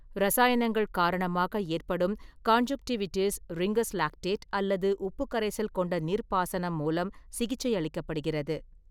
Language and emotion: Tamil, neutral